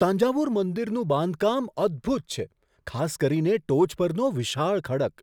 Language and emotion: Gujarati, surprised